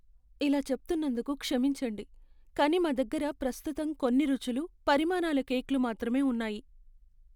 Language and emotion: Telugu, sad